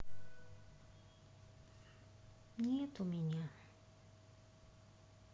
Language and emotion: Russian, sad